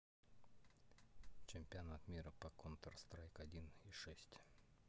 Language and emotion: Russian, neutral